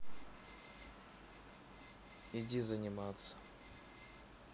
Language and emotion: Russian, neutral